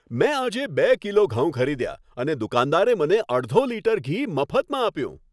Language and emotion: Gujarati, happy